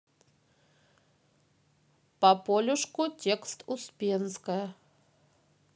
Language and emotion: Russian, neutral